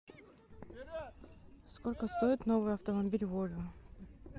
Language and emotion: Russian, neutral